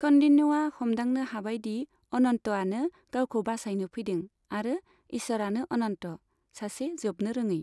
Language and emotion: Bodo, neutral